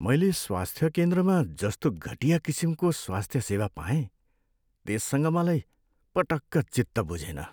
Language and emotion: Nepali, sad